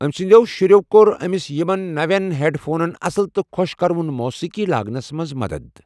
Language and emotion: Kashmiri, neutral